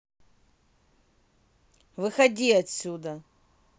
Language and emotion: Russian, angry